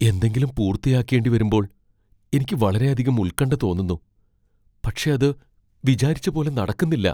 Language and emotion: Malayalam, fearful